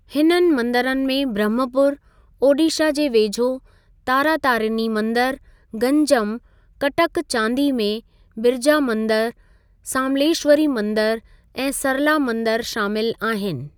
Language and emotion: Sindhi, neutral